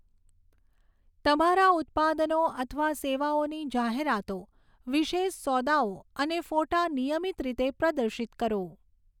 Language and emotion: Gujarati, neutral